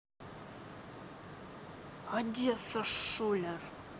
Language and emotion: Russian, angry